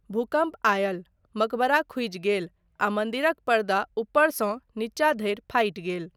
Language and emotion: Maithili, neutral